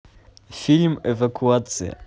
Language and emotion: Russian, positive